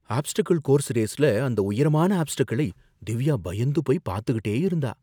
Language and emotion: Tamil, fearful